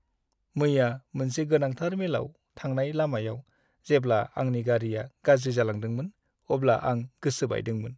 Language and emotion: Bodo, sad